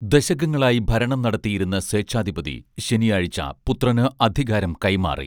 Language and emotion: Malayalam, neutral